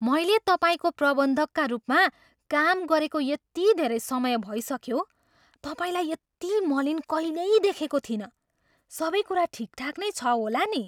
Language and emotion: Nepali, surprised